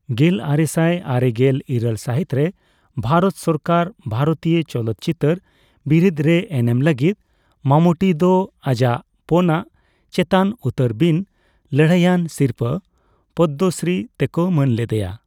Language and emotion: Santali, neutral